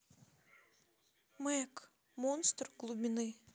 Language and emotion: Russian, sad